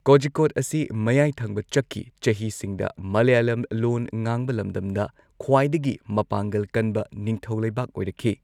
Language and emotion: Manipuri, neutral